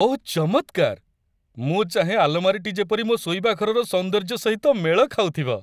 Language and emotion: Odia, happy